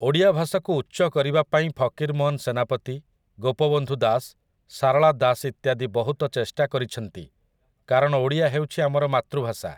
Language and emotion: Odia, neutral